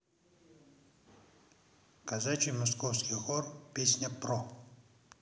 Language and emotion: Russian, neutral